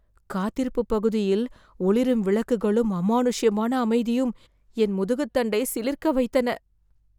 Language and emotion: Tamil, fearful